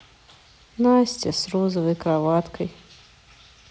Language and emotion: Russian, sad